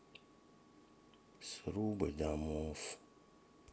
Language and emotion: Russian, sad